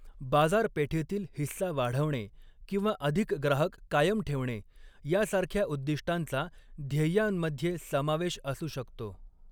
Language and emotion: Marathi, neutral